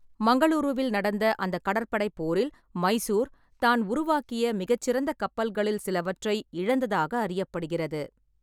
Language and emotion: Tamil, neutral